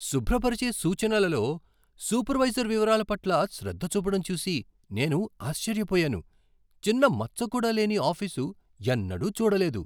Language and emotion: Telugu, surprised